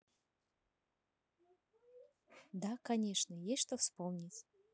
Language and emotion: Russian, neutral